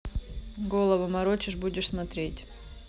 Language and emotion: Russian, neutral